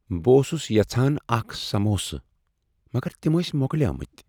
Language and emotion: Kashmiri, sad